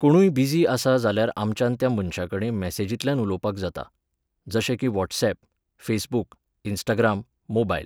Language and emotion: Goan Konkani, neutral